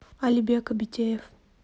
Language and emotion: Russian, neutral